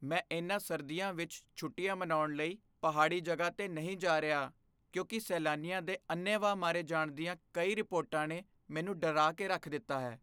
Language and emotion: Punjabi, fearful